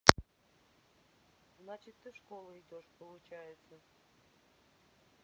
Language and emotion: Russian, neutral